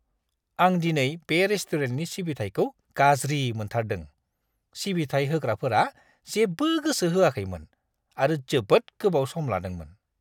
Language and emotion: Bodo, disgusted